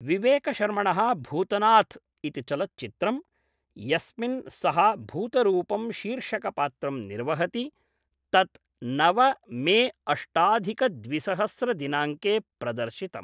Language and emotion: Sanskrit, neutral